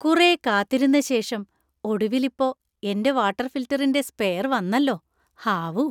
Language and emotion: Malayalam, happy